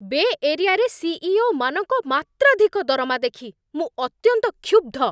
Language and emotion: Odia, angry